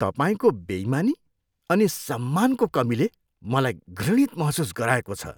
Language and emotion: Nepali, disgusted